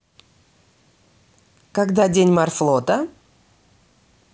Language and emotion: Russian, positive